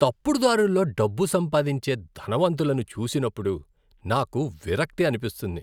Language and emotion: Telugu, disgusted